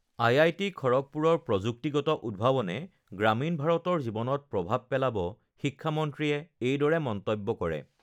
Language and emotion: Assamese, neutral